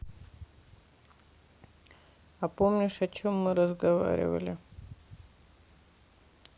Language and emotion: Russian, sad